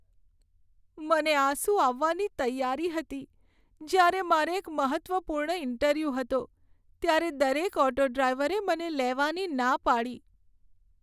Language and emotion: Gujarati, sad